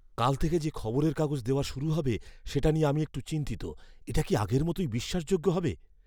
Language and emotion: Bengali, fearful